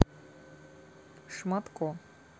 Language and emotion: Russian, neutral